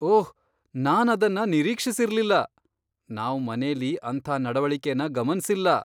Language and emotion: Kannada, surprised